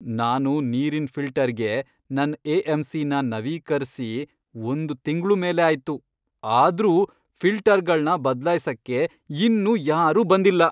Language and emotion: Kannada, angry